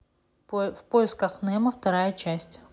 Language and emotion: Russian, neutral